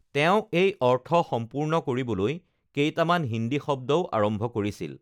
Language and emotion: Assamese, neutral